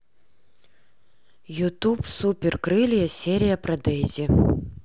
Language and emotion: Russian, neutral